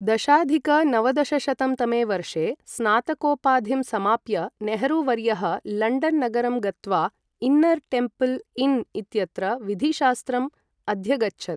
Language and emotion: Sanskrit, neutral